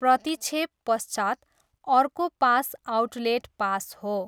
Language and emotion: Nepali, neutral